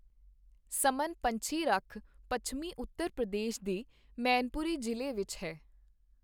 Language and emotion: Punjabi, neutral